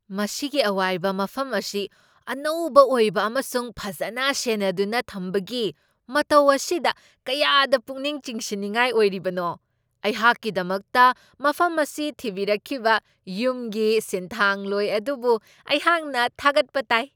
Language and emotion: Manipuri, surprised